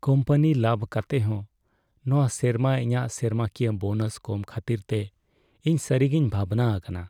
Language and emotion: Santali, sad